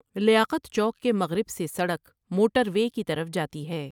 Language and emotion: Urdu, neutral